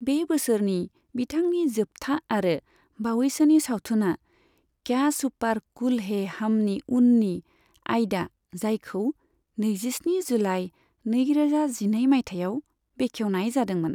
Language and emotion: Bodo, neutral